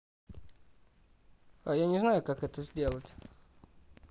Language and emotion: Russian, neutral